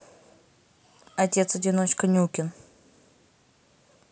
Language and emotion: Russian, neutral